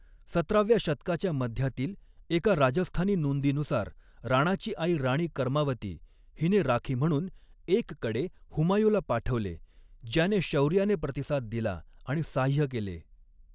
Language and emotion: Marathi, neutral